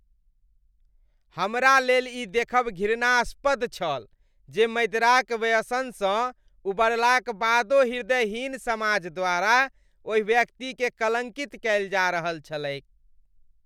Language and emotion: Maithili, disgusted